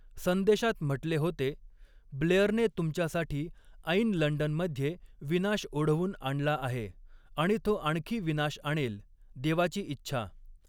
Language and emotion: Marathi, neutral